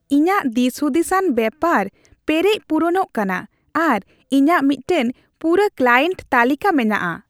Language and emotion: Santali, happy